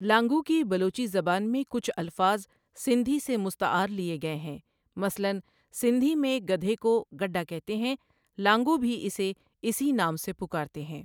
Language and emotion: Urdu, neutral